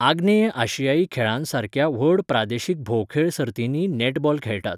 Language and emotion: Goan Konkani, neutral